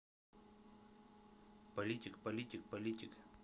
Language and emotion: Russian, neutral